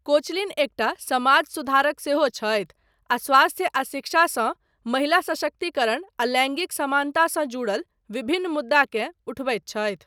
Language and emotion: Maithili, neutral